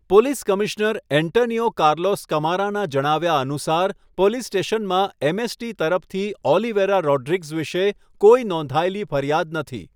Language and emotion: Gujarati, neutral